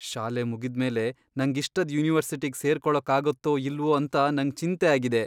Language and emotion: Kannada, fearful